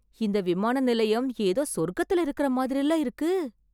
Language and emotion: Tamil, surprised